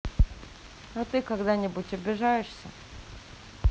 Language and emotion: Russian, neutral